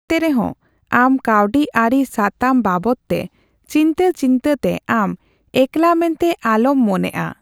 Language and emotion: Santali, neutral